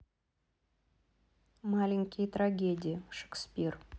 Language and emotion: Russian, neutral